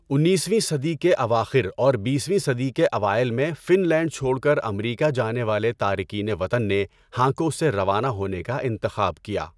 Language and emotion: Urdu, neutral